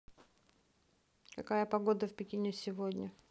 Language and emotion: Russian, neutral